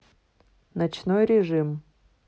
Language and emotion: Russian, neutral